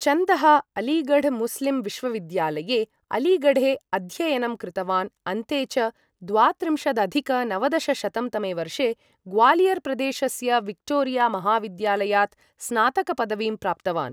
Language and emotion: Sanskrit, neutral